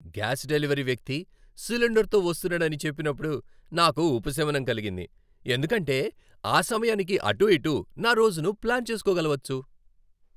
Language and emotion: Telugu, happy